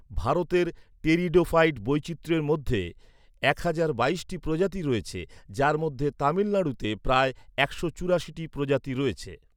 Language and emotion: Bengali, neutral